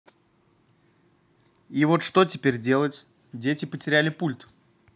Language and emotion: Russian, neutral